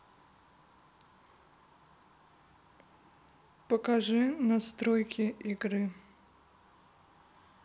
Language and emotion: Russian, neutral